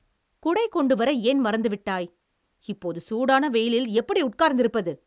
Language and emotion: Tamil, angry